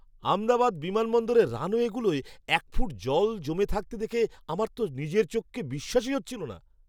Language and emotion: Bengali, surprised